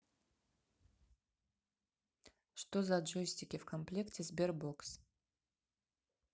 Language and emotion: Russian, neutral